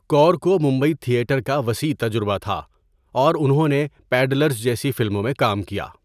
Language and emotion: Urdu, neutral